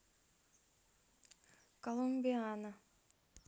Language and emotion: Russian, neutral